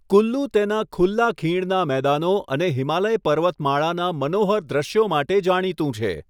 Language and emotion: Gujarati, neutral